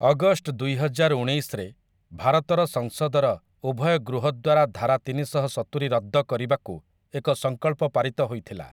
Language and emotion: Odia, neutral